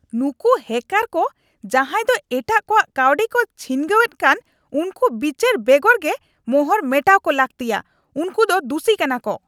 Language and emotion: Santali, angry